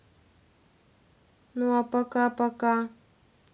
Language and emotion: Russian, neutral